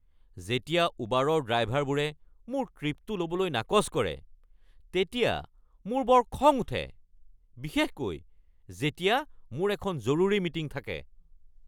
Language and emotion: Assamese, angry